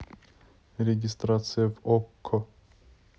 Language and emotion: Russian, neutral